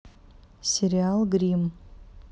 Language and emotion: Russian, neutral